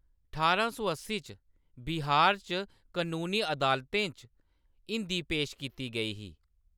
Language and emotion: Dogri, neutral